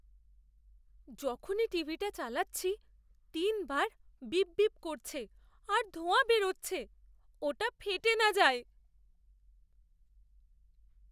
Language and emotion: Bengali, fearful